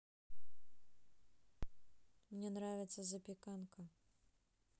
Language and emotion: Russian, neutral